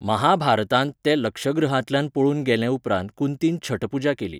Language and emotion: Goan Konkani, neutral